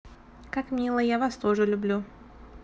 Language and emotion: Russian, neutral